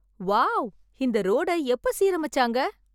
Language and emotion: Tamil, surprised